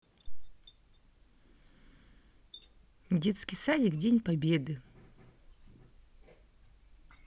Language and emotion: Russian, neutral